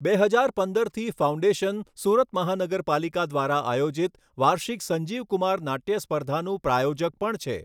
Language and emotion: Gujarati, neutral